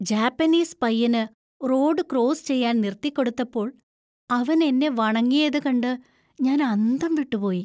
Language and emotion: Malayalam, surprised